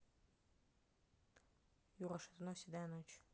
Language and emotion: Russian, neutral